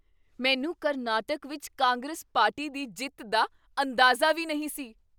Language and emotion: Punjabi, surprised